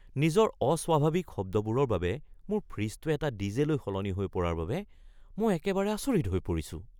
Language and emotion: Assamese, surprised